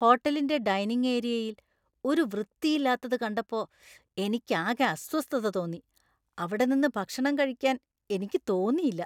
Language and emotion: Malayalam, disgusted